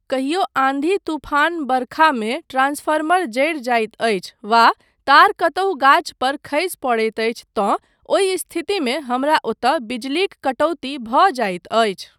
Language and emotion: Maithili, neutral